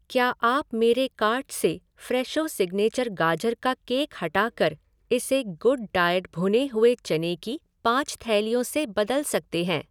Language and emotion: Hindi, neutral